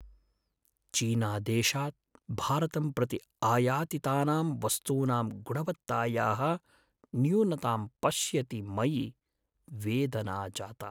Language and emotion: Sanskrit, sad